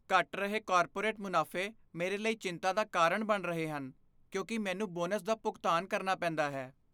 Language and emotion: Punjabi, fearful